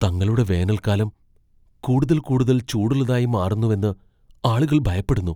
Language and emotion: Malayalam, fearful